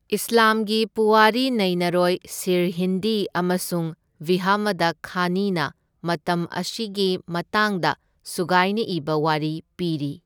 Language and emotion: Manipuri, neutral